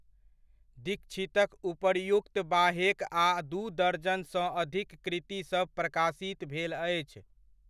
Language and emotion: Maithili, neutral